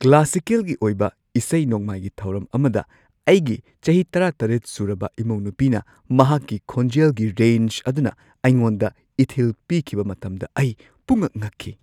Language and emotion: Manipuri, surprised